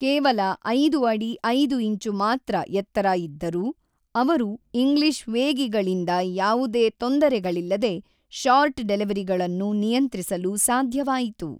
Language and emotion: Kannada, neutral